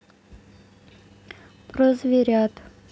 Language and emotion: Russian, neutral